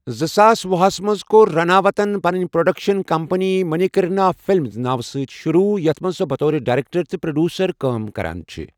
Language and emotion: Kashmiri, neutral